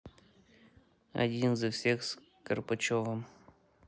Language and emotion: Russian, neutral